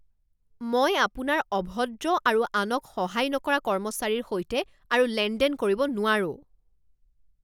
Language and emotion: Assamese, angry